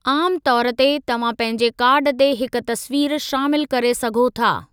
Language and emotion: Sindhi, neutral